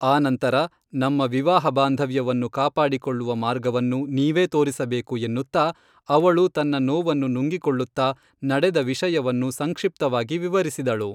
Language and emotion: Kannada, neutral